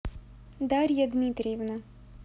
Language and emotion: Russian, neutral